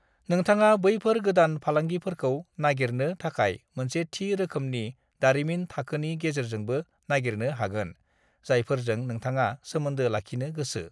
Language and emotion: Bodo, neutral